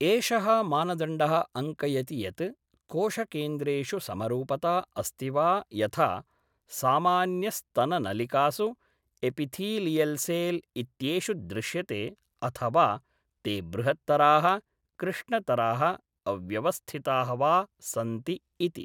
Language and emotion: Sanskrit, neutral